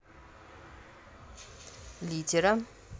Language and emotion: Russian, neutral